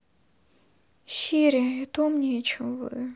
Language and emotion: Russian, sad